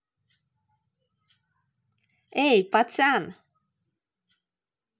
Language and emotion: Russian, positive